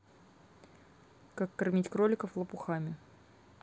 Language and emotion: Russian, neutral